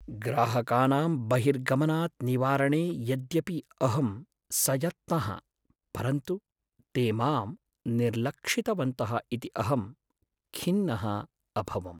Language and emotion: Sanskrit, sad